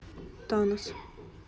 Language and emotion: Russian, neutral